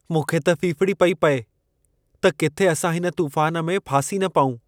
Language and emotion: Sindhi, fearful